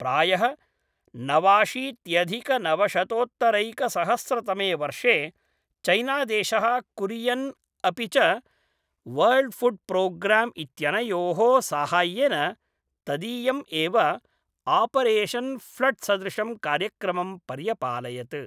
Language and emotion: Sanskrit, neutral